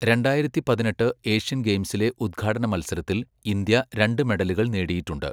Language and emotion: Malayalam, neutral